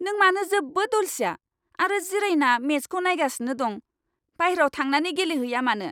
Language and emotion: Bodo, angry